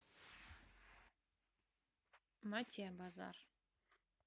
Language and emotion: Russian, neutral